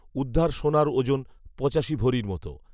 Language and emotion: Bengali, neutral